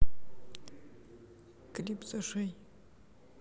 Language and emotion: Russian, neutral